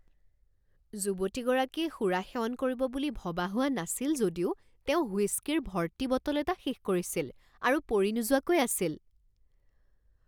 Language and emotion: Assamese, surprised